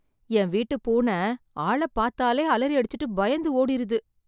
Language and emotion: Tamil, sad